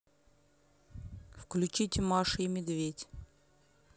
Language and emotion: Russian, neutral